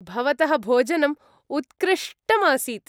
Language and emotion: Sanskrit, happy